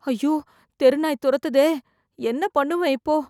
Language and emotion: Tamil, fearful